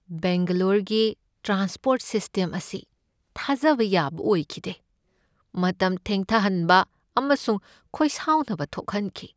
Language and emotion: Manipuri, sad